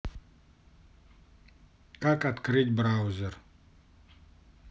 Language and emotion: Russian, neutral